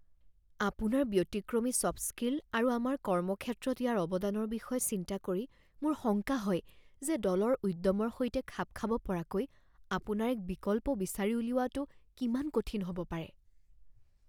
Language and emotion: Assamese, fearful